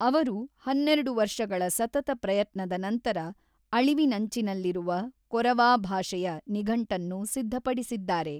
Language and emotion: Kannada, neutral